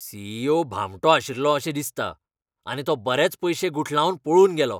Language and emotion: Goan Konkani, angry